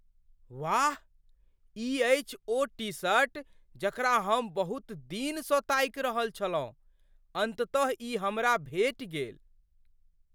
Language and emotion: Maithili, surprised